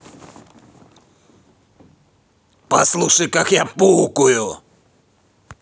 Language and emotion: Russian, angry